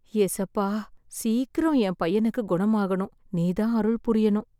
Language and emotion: Tamil, sad